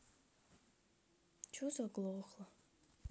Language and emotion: Russian, sad